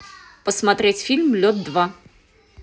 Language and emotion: Russian, neutral